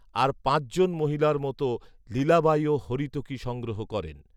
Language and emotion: Bengali, neutral